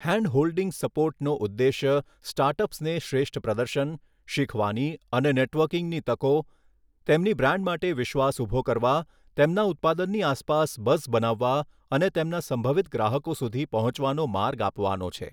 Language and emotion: Gujarati, neutral